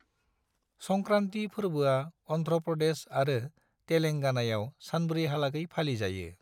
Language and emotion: Bodo, neutral